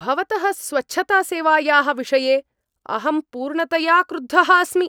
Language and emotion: Sanskrit, angry